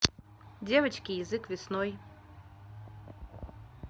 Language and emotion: Russian, neutral